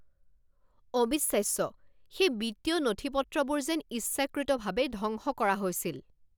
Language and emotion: Assamese, angry